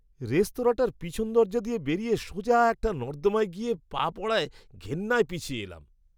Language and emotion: Bengali, disgusted